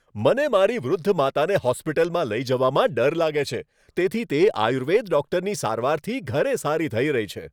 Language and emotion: Gujarati, happy